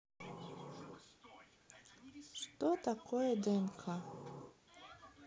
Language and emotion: Russian, neutral